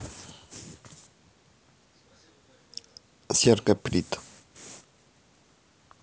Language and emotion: Russian, neutral